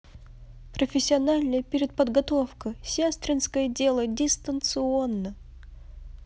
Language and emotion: Russian, positive